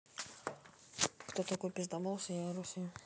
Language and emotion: Russian, neutral